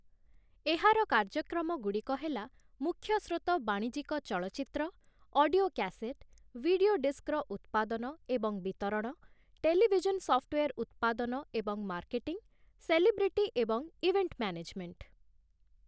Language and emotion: Odia, neutral